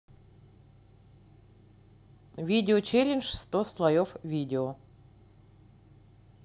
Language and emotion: Russian, neutral